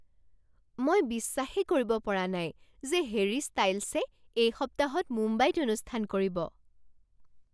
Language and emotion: Assamese, surprised